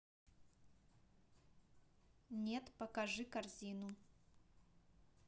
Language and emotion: Russian, neutral